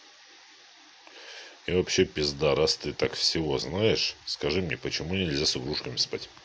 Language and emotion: Russian, angry